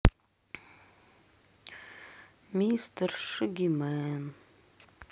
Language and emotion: Russian, sad